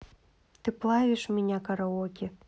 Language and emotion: Russian, neutral